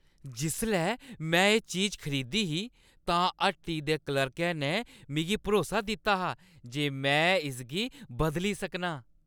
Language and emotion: Dogri, happy